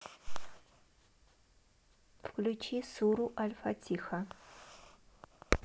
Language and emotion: Russian, neutral